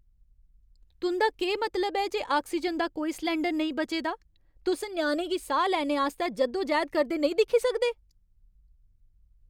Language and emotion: Dogri, angry